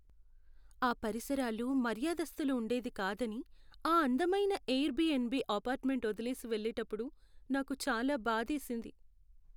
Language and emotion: Telugu, sad